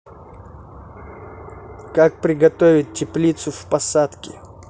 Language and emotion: Russian, neutral